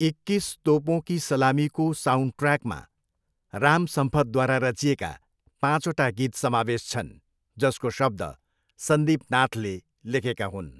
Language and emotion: Nepali, neutral